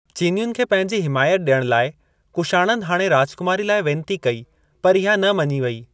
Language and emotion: Sindhi, neutral